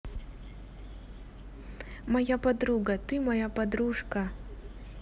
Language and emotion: Russian, positive